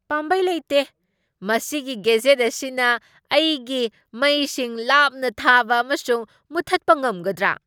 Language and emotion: Manipuri, surprised